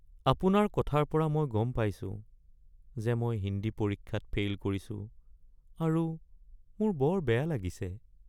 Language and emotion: Assamese, sad